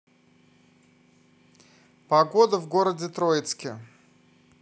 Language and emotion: Russian, neutral